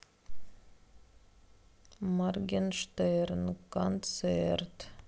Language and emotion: Russian, sad